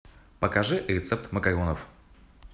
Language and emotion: Russian, positive